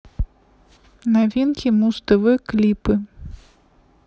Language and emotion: Russian, neutral